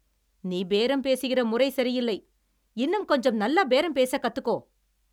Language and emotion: Tamil, angry